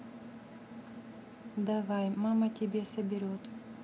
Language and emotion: Russian, neutral